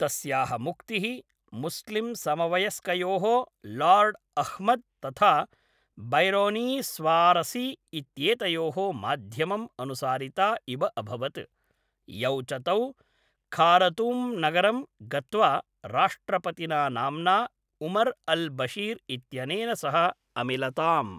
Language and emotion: Sanskrit, neutral